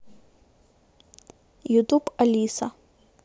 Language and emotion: Russian, neutral